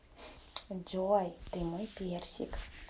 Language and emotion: Russian, positive